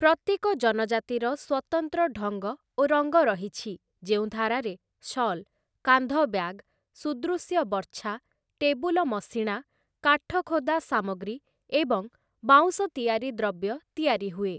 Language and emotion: Odia, neutral